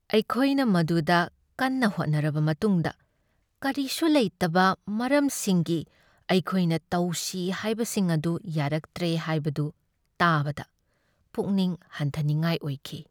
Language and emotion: Manipuri, sad